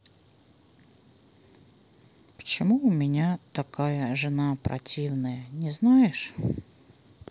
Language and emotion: Russian, sad